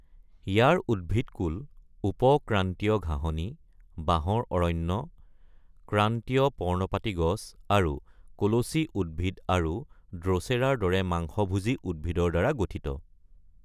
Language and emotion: Assamese, neutral